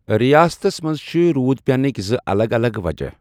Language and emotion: Kashmiri, neutral